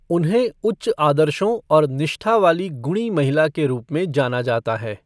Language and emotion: Hindi, neutral